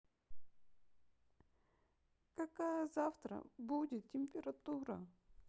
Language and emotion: Russian, sad